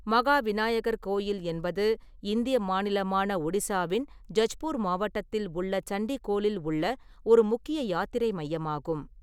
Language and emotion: Tamil, neutral